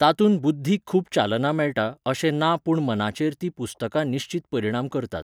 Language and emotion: Goan Konkani, neutral